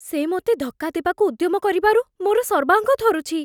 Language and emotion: Odia, fearful